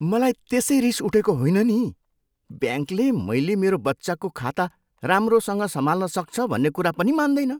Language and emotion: Nepali, disgusted